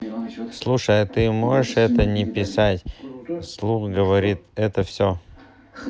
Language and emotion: Russian, neutral